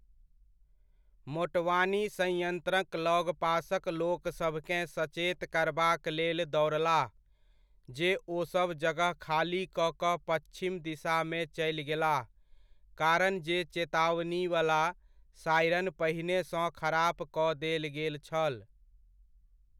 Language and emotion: Maithili, neutral